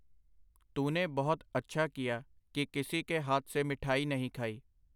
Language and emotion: Punjabi, neutral